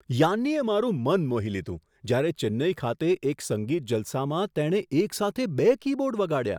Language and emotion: Gujarati, surprised